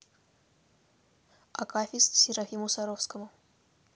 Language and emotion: Russian, neutral